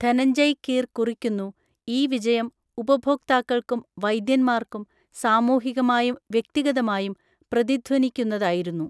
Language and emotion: Malayalam, neutral